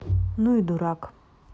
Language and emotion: Russian, neutral